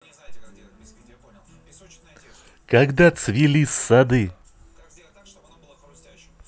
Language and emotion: Russian, positive